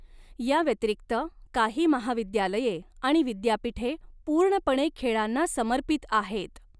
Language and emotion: Marathi, neutral